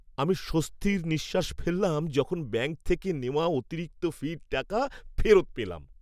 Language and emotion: Bengali, happy